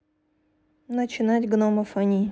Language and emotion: Russian, neutral